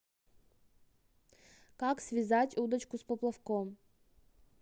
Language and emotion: Russian, neutral